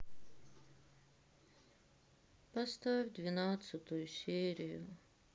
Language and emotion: Russian, sad